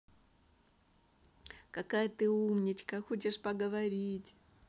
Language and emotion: Russian, positive